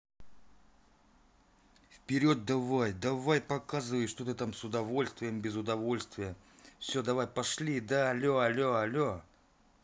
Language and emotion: Russian, angry